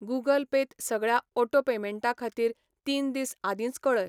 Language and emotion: Goan Konkani, neutral